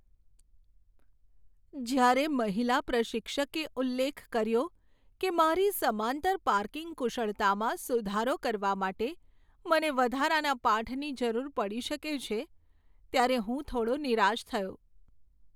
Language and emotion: Gujarati, sad